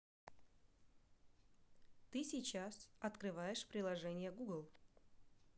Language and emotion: Russian, neutral